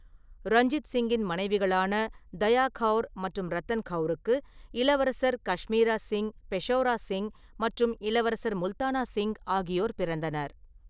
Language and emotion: Tamil, neutral